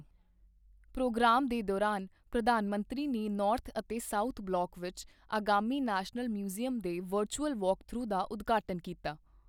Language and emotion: Punjabi, neutral